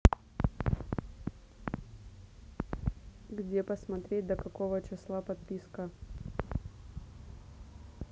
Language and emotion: Russian, neutral